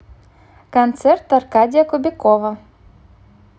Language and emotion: Russian, positive